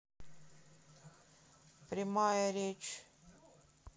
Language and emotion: Russian, neutral